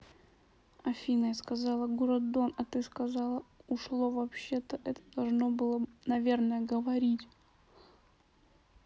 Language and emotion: Russian, neutral